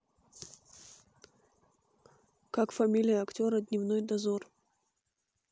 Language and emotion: Russian, neutral